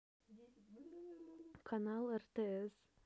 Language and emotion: Russian, neutral